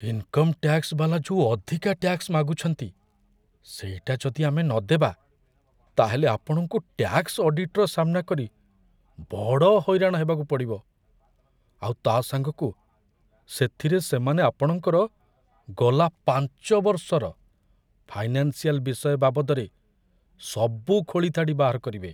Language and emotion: Odia, fearful